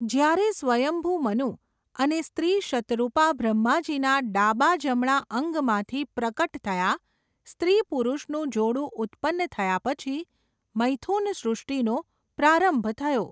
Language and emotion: Gujarati, neutral